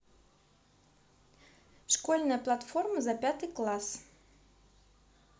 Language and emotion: Russian, neutral